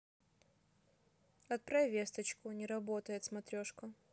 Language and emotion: Russian, neutral